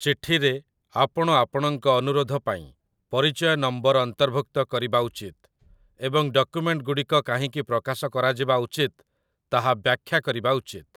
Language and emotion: Odia, neutral